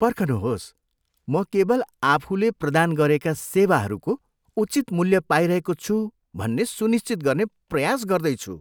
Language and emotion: Nepali, disgusted